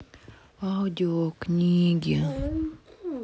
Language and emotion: Russian, sad